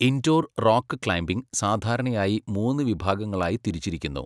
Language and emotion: Malayalam, neutral